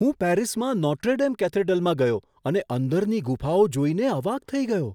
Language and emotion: Gujarati, surprised